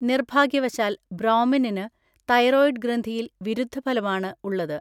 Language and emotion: Malayalam, neutral